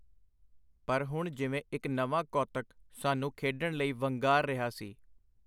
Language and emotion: Punjabi, neutral